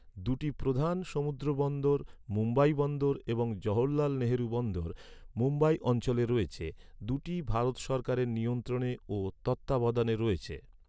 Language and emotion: Bengali, neutral